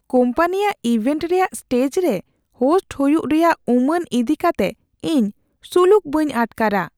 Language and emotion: Santali, fearful